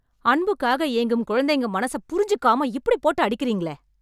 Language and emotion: Tamil, angry